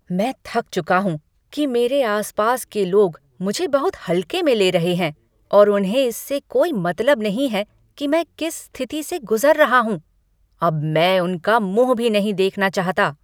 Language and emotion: Hindi, angry